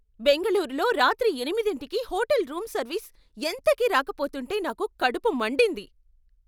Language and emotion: Telugu, angry